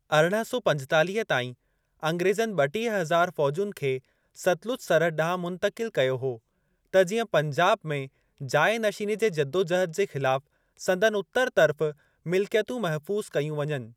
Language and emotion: Sindhi, neutral